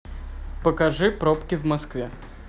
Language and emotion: Russian, neutral